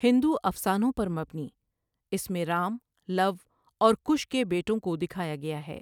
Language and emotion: Urdu, neutral